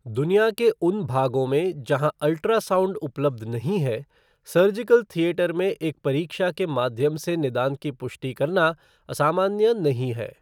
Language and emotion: Hindi, neutral